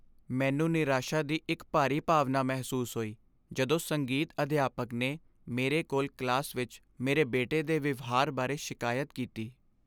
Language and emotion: Punjabi, sad